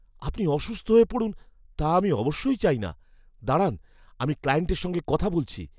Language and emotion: Bengali, fearful